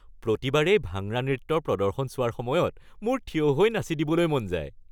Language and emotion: Assamese, happy